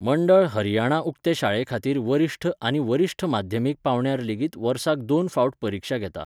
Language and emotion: Goan Konkani, neutral